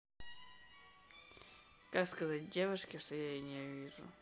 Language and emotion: Russian, neutral